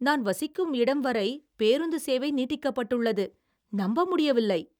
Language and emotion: Tamil, surprised